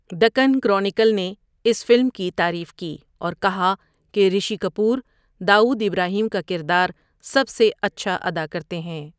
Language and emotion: Urdu, neutral